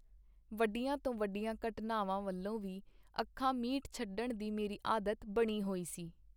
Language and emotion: Punjabi, neutral